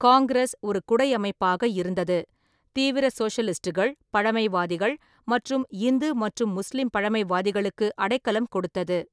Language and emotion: Tamil, neutral